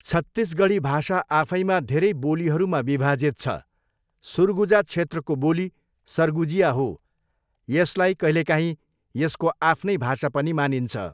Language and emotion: Nepali, neutral